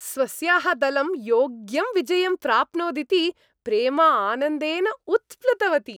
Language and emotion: Sanskrit, happy